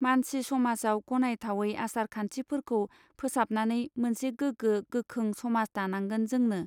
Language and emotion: Bodo, neutral